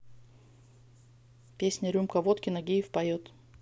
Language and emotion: Russian, neutral